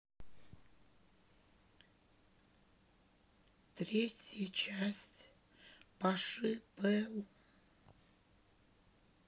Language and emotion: Russian, sad